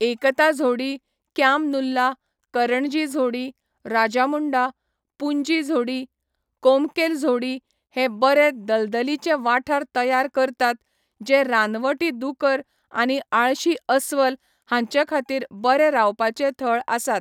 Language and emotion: Goan Konkani, neutral